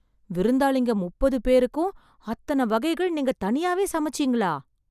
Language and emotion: Tamil, surprised